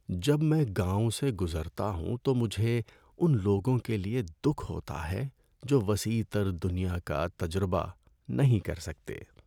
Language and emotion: Urdu, sad